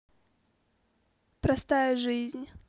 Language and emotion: Russian, neutral